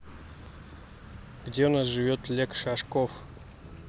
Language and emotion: Russian, neutral